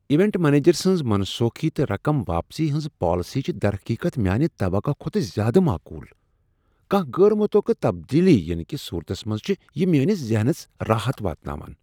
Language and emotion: Kashmiri, surprised